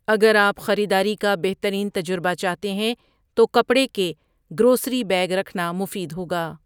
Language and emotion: Urdu, neutral